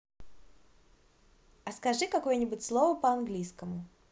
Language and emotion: Russian, positive